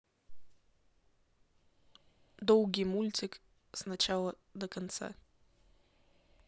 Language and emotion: Russian, neutral